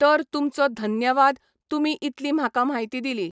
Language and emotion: Goan Konkani, neutral